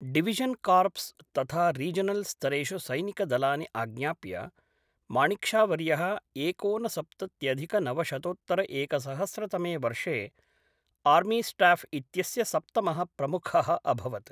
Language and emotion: Sanskrit, neutral